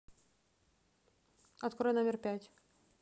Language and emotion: Russian, neutral